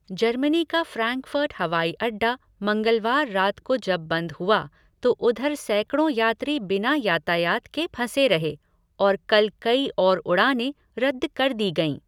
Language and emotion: Hindi, neutral